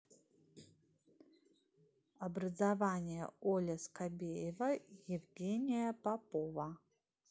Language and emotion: Russian, neutral